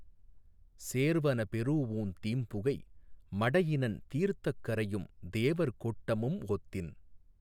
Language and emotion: Tamil, neutral